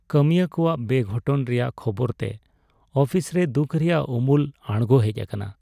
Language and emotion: Santali, sad